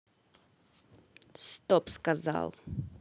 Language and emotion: Russian, neutral